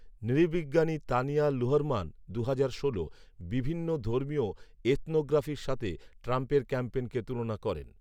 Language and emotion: Bengali, neutral